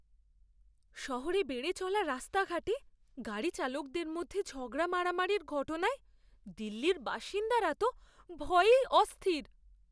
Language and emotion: Bengali, fearful